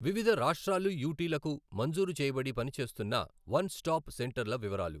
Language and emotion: Telugu, neutral